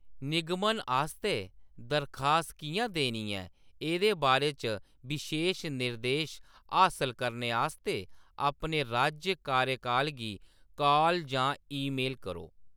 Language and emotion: Dogri, neutral